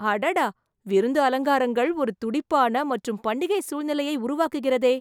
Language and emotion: Tamil, surprised